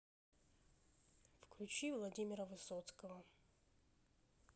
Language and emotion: Russian, neutral